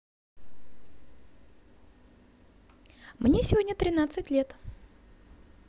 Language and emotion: Russian, positive